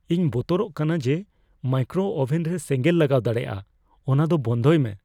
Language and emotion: Santali, fearful